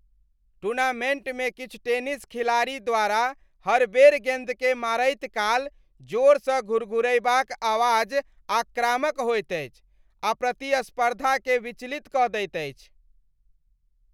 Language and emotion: Maithili, disgusted